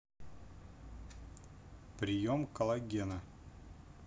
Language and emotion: Russian, neutral